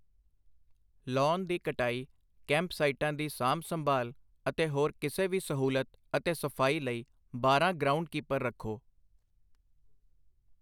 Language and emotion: Punjabi, neutral